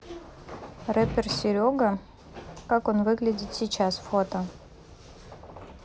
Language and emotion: Russian, neutral